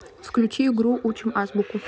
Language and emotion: Russian, neutral